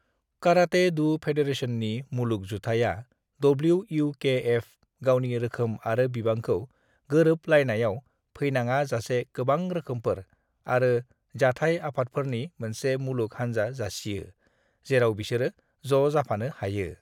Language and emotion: Bodo, neutral